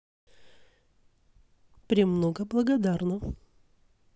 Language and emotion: Russian, positive